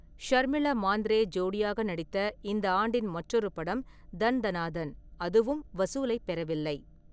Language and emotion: Tamil, neutral